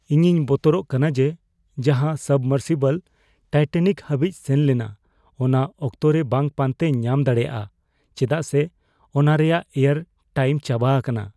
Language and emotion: Santali, fearful